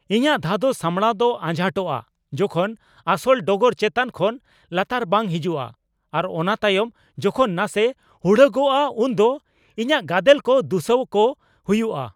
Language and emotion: Santali, angry